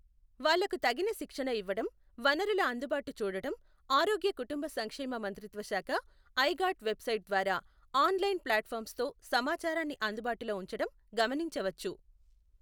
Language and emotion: Telugu, neutral